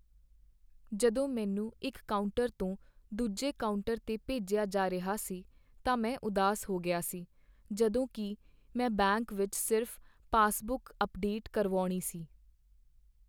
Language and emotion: Punjabi, sad